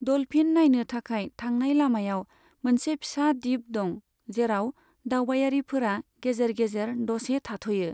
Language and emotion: Bodo, neutral